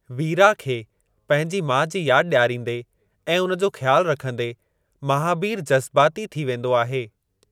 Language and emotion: Sindhi, neutral